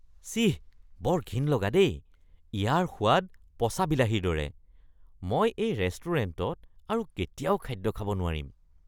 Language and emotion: Assamese, disgusted